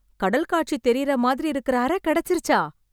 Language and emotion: Tamil, surprised